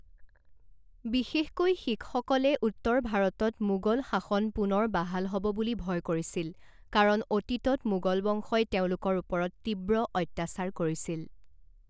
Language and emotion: Assamese, neutral